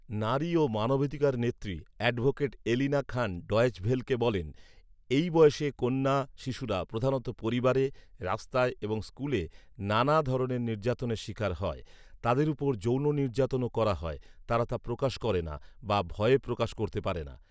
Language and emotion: Bengali, neutral